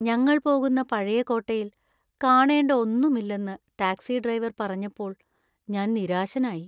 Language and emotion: Malayalam, sad